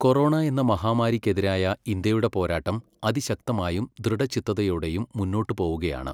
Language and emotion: Malayalam, neutral